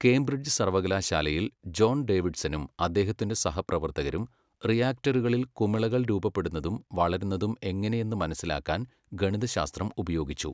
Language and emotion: Malayalam, neutral